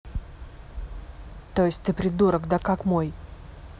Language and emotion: Russian, angry